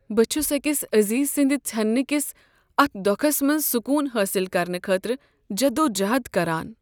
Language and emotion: Kashmiri, sad